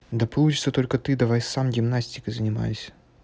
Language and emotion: Russian, neutral